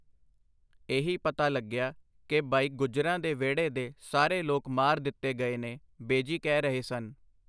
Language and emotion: Punjabi, neutral